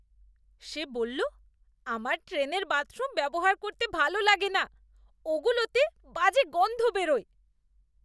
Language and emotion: Bengali, disgusted